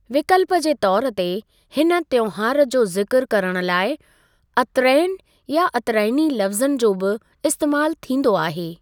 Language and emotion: Sindhi, neutral